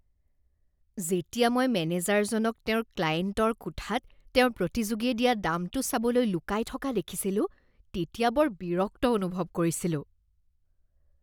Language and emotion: Assamese, disgusted